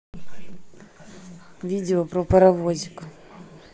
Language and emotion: Russian, neutral